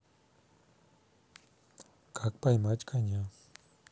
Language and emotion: Russian, neutral